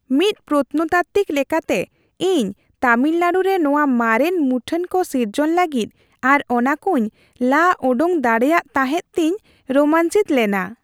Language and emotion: Santali, happy